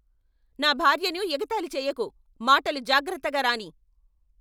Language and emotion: Telugu, angry